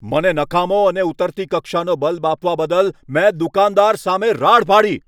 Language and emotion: Gujarati, angry